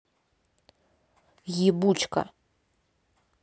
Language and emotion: Russian, angry